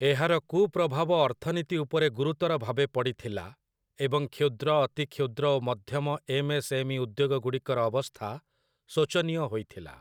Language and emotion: Odia, neutral